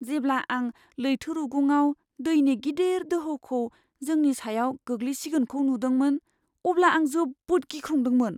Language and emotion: Bodo, fearful